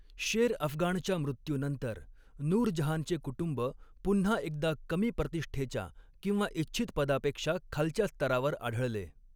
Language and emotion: Marathi, neutral